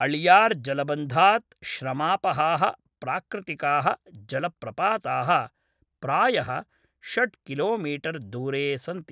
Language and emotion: Sanskrit, neutral